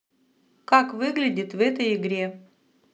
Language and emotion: Russian, neutral